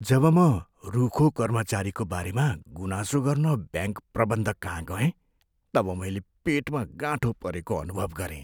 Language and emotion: Nepali, fearful